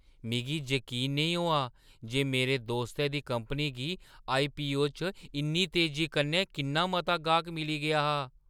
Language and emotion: Dogri, surprised